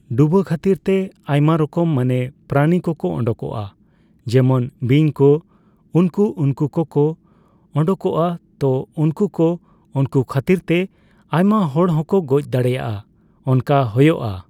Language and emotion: Santali, neutral